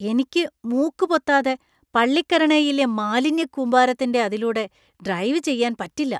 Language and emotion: Malayalam, disgusted